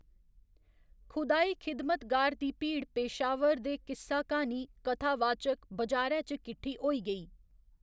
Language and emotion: Dogri, neutral